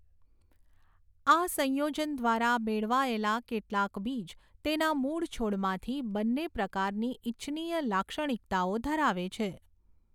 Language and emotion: Gujarati, neutral